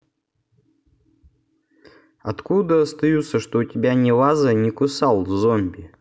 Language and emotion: Russian, neutral